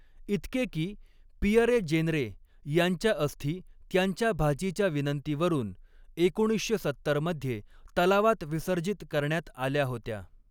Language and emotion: Marathi, neutral